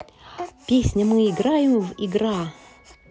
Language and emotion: Russian, positive